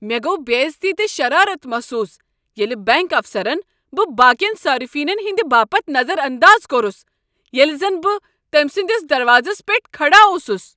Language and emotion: Kashmiri, angry